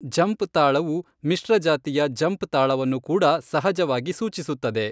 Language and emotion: Kannada, neutral